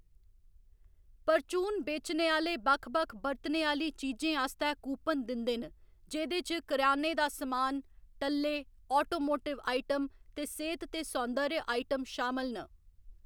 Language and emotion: Dogri, neutral